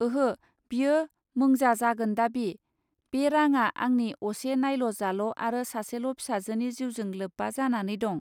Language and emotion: Bodo, neutral